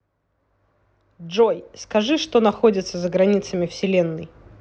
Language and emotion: Russian, neutral